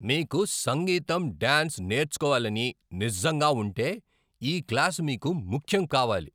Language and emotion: Telugu, angry